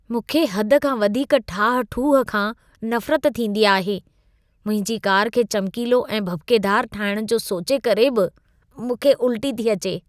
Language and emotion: Sindhi, disgusted